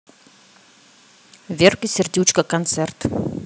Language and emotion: Russian, neutral